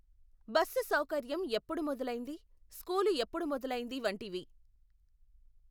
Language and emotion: Telugu, neutral